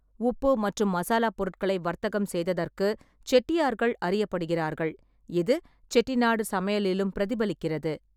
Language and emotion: Tamil, neutral